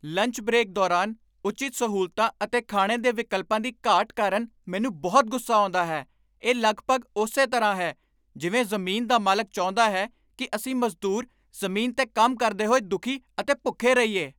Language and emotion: Punjabi, angry